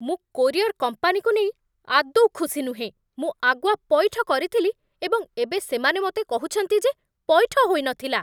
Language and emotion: Odia, angry